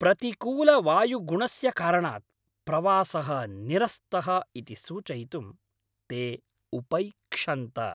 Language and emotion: Sanskrit, angry